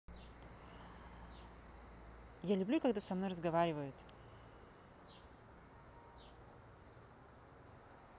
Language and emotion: Russian, neutral